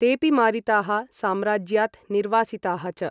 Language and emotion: Sanskrit, neutral